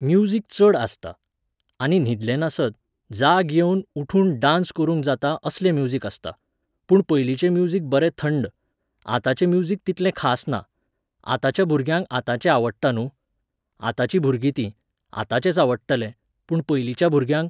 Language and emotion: Goan Konkani, neutral